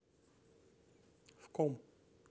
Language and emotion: Russian, neutral